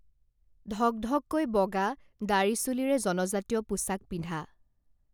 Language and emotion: Assamese, neutral